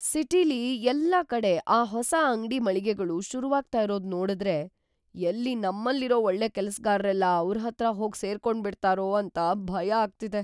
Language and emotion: Kannada, fearful